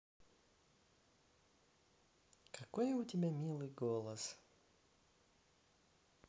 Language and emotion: Russian, positive